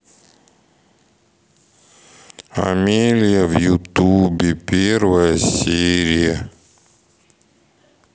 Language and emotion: Russian, sad